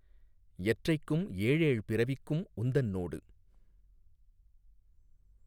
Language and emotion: Tamil, neutral